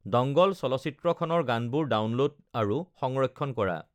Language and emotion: Assamese, neutral